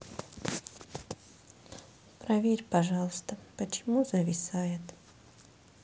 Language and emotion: Russian, sad